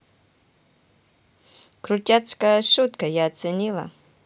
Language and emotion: Russian, positive